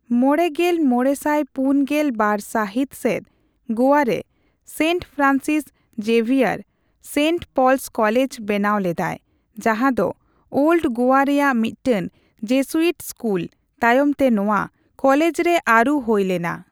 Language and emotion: Santali, neutral